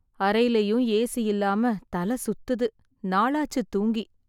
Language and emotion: Tamil, sad